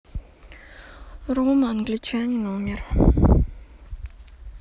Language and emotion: Russian, neutral